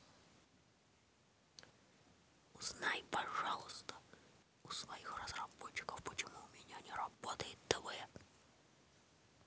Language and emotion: Russian, neutral